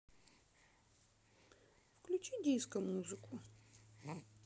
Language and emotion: Russian, neutral